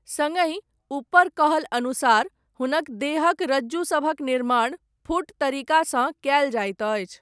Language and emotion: Maithili, neutral